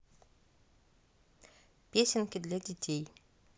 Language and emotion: Russian, neutral